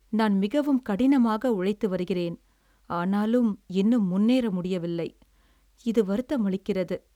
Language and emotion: Tamil, sad